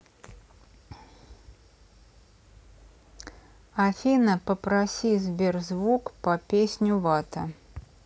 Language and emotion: Russian, neutral